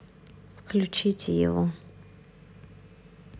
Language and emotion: Russian, neutral